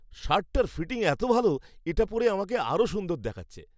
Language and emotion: Bengali, happy